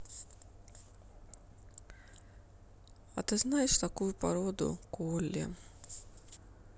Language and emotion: Russian, sad